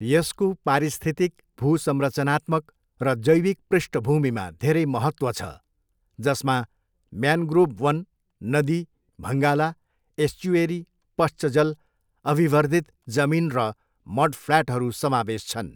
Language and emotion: Nepali, neutral